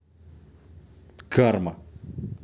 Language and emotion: Russian, neutral